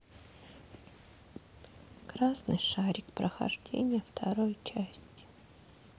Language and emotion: Russian, sad